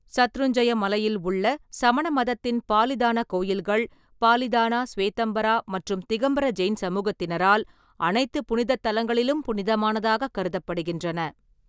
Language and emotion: Tamil, neutral